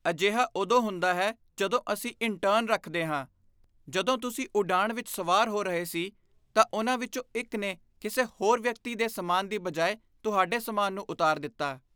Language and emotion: Punjabi, disgusted